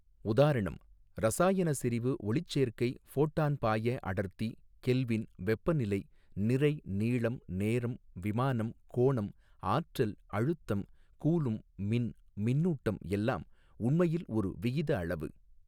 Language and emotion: Tamil, neutral